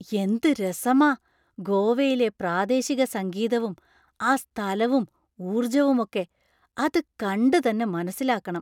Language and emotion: Malayalam, surprised